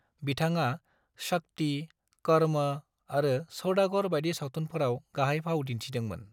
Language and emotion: Bodo, neutral